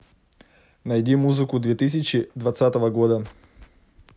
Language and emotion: Russian, neutral